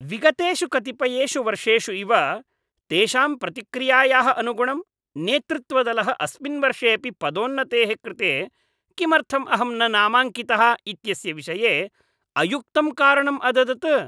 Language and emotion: Sanskrit, disgusted